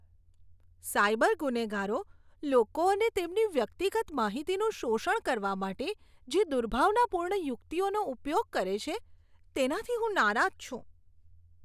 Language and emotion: Gujarati, disgusted